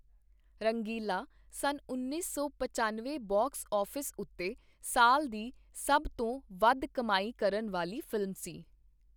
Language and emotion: Punjabi, neutral